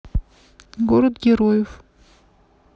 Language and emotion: Russian, neutral